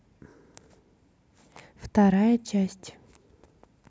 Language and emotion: Russian, neutral